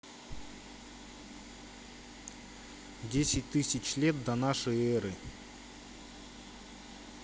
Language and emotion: Russian, neutral